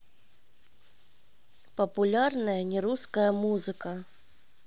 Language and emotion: Russian, neutral